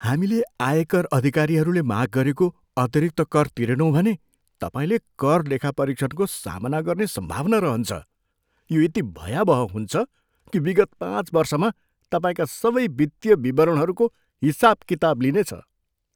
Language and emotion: Nepali, fearful